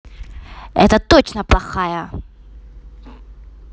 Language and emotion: Russian, angry